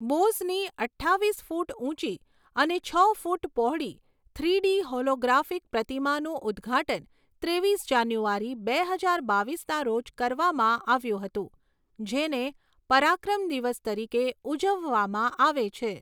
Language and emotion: Gujarati, neutral